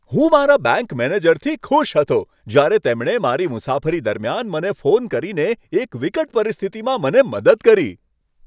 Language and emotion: Gujarati, happy